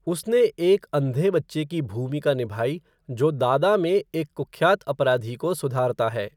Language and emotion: Hindi, neutral